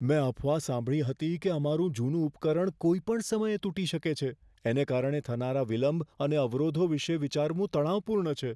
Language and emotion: Gujarati, fearful